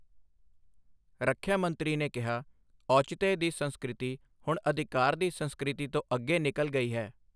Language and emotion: Punjabi, neutral